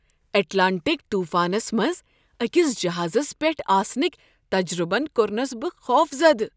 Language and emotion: Kashmiri, surprised